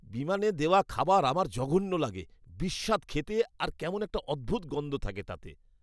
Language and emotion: Bengali, disgusted